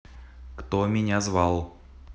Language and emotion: Russian, neutral